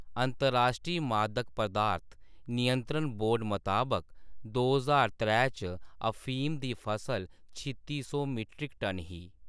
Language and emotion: Dogri, neutral